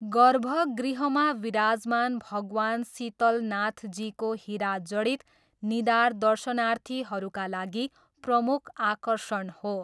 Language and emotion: Nepali, neutral